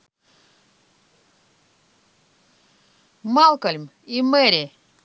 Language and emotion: Russian, neutral